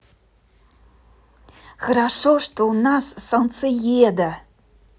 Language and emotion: Russian, positive